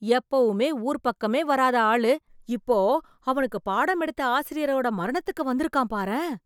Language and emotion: Tamil, surprised